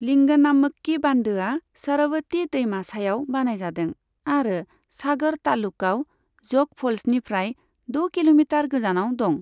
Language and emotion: Bodo, neutral